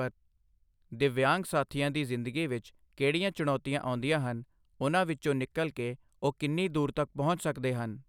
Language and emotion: Punjabi, neutral